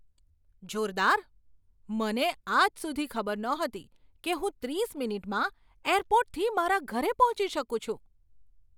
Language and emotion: Gujarati, surprised